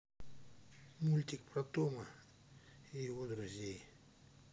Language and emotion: Russian, neutral